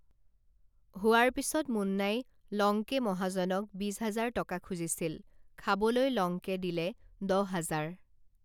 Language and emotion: Assamese, neutral